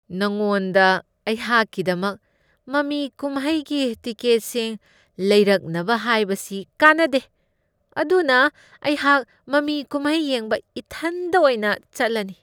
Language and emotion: Manipuri, disgusted